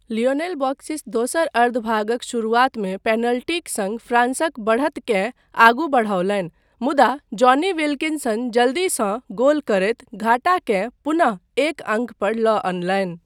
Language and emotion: Maithili, neutral